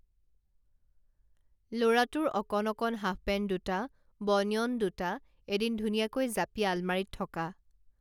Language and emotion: Assamese, neutral